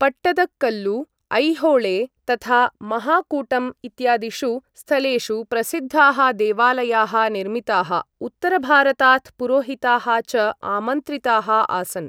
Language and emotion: Sanskrit, neutral